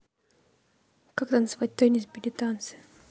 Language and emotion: Russian, neutral